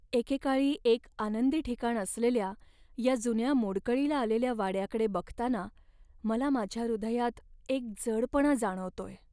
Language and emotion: Marathi, sad